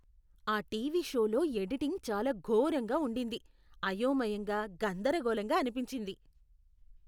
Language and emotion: Telugu, disgusted